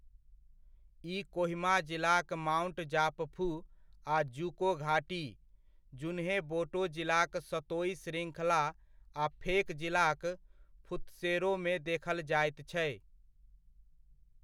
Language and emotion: Maithili, neutral